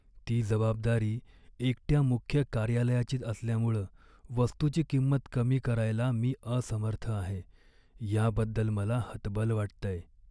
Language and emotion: Marathi, sad